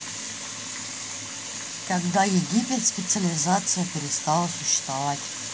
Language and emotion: Russian, neutral